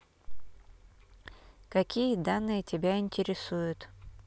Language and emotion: Russian, neutral